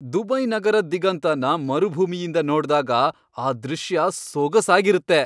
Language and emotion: Kannada, happy